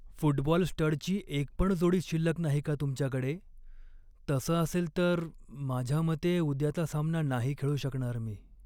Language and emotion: Marathi, sad